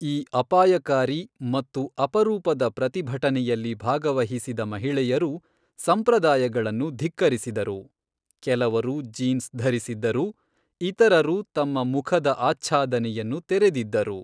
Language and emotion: Kannada, neutral